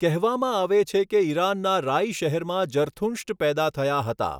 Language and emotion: Gujarati, neutral